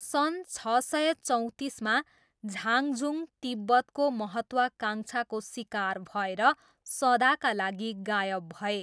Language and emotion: Nepali, neutral